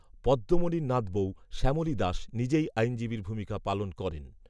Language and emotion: Bengali, neutral